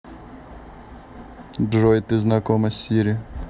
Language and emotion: Russian, neutral